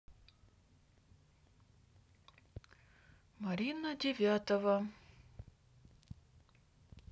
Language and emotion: Russian, neutral